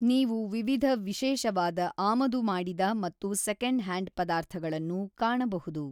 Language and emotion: Kannada, neutral